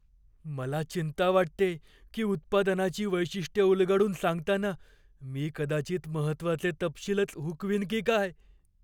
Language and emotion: Marathi, fearful